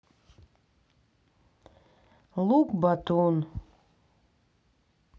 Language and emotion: Russian, sad